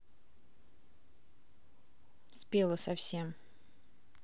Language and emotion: Russian, neutral